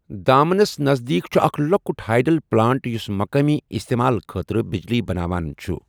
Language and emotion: Kashmiri, neutral